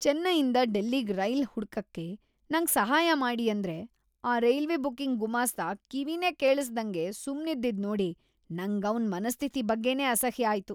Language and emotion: Kannada, disgusted